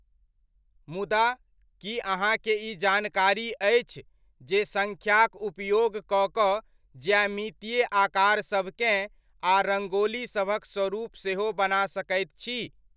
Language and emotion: Maithili, neutral